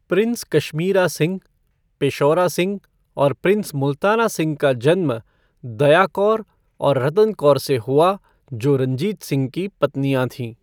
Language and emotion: Hindi, neutral